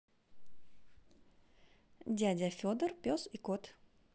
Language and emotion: Russian, positive